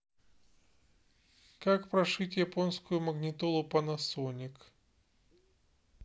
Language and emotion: Russian, neutral